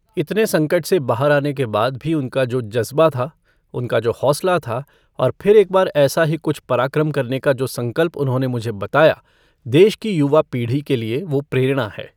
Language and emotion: Hindi, neutral